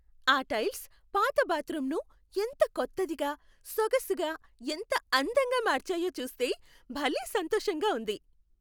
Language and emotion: Telugu, happy